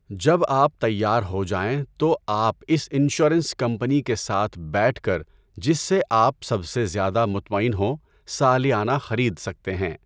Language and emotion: Urdu, neutral